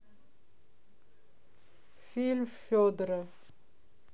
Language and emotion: Russian, neutral